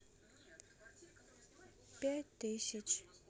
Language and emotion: Russian, sad